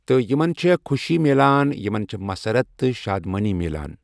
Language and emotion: Kashmiri, neutral